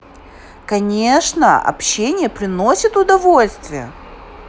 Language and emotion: Russian, positive